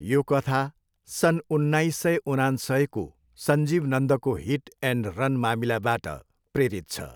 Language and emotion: Nepali, neutral